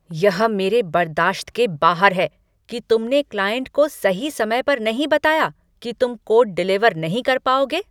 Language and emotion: Hindi, angry